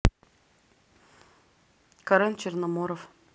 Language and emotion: Russian, neutral